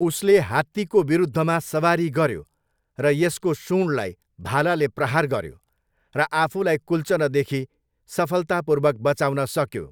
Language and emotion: Nepali, neutral